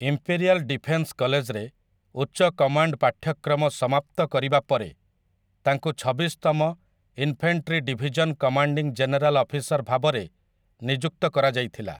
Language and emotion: Odia, neutral